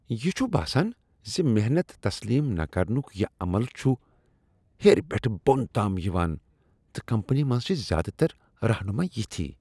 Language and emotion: Kashmiri, disgusted